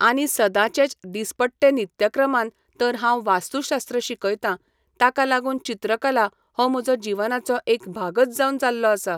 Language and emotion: Goan Konkani, neutral